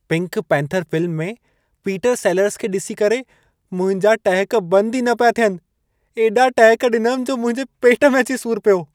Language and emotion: Sindhi, happy